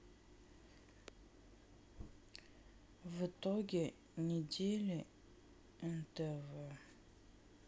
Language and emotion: Russian, sad